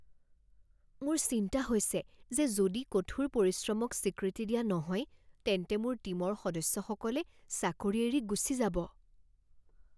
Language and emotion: Assamese, fearful